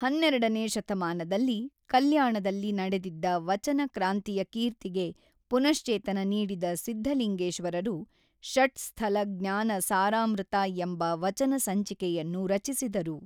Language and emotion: Kannada, neutral